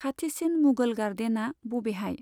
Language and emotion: Bodo, neutral